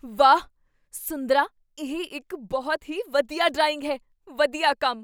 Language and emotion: Punjabi, surprised